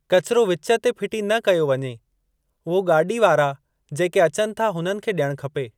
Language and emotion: Sindhi, neutral